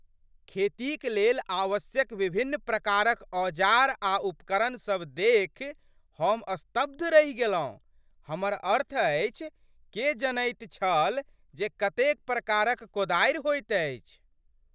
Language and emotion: Maithili, surprised